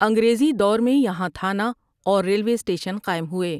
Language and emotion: Urdu, neutral